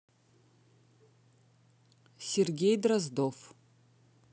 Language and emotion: Russian, neutral